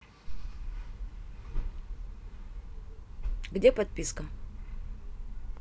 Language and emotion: Russian, neutral